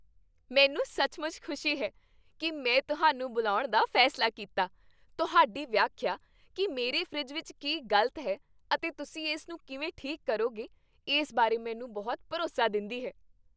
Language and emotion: Punjabi, happy